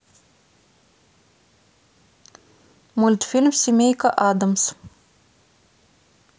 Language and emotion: Russian, neutral